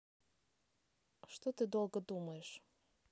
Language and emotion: Russian, neutral